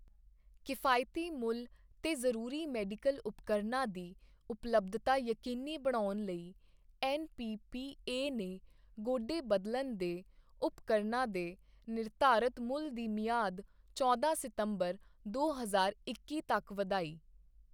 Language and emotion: Punjabi, neutral